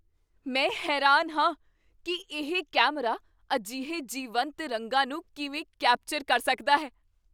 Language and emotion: Punjabi, surprised